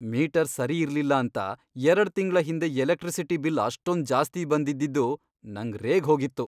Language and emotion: Kannada, angry